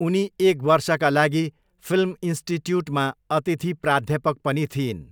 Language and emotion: Nepali, neutral